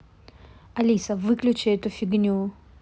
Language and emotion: Russian, angry